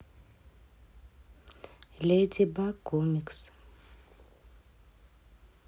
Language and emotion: Russian, neutral